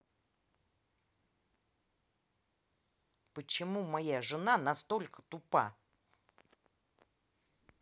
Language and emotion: Russian, angry